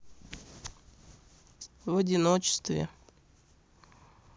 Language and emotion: Russian, sad